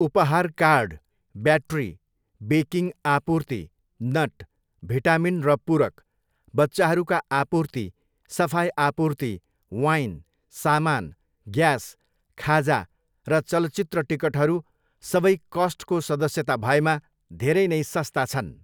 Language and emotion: Nepali, neutral